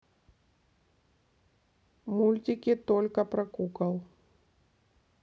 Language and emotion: Russian, neutral